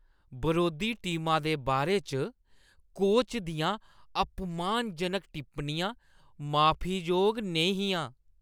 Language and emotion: Dogri, disgusted